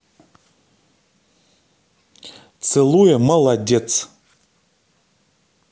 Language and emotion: Russian, positive